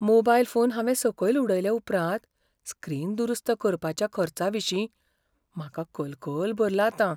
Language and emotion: Goan Konkani, fearful